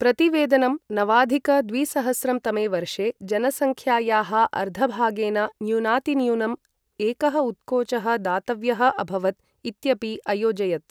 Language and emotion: Sanskrit, neutral